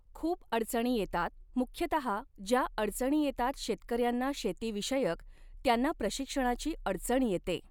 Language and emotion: Marathi, neutral